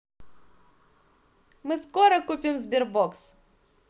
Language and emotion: Russian, positive